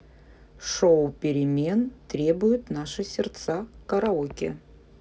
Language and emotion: Russian, neutral